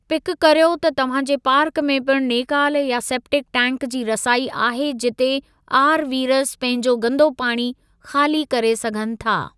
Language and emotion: Sindhi, neutral